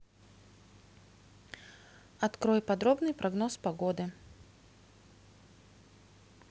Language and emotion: Russian, neutral